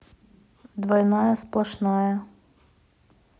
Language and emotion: Russian, neutral